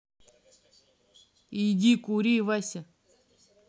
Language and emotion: Russian, neutral